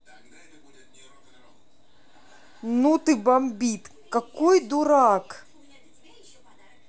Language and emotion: Russian, angry